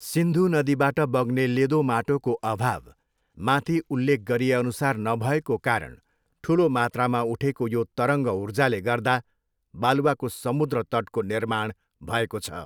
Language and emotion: Nepali, neutral